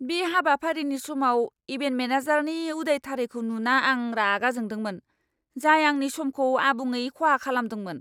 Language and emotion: Bodo, angry